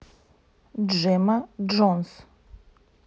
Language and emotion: Russian, neutral